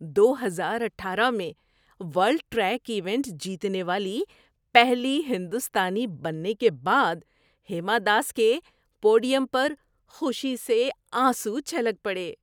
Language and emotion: Urdu, happy